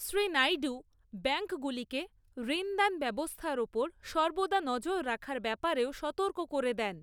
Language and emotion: Bengali, neutral